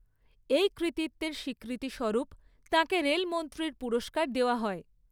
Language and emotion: Bengali, neutral